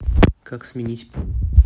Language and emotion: Russian, neutral